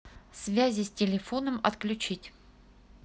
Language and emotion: Russian, neutral